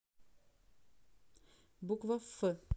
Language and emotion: Russian, neutral